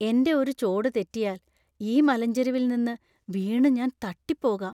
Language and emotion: Malayalam, fearful